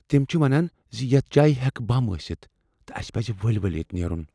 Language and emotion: Kashmiri, fearful